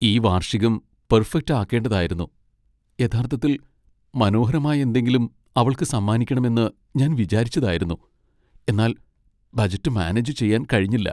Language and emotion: Malayalam, sad